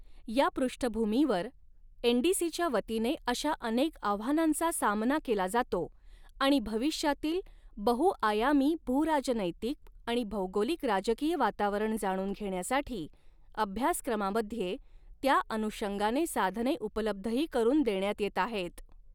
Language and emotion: Marathi, neutral